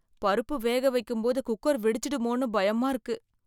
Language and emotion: Tamil, fearful